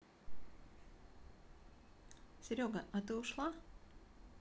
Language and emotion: Russian, neutral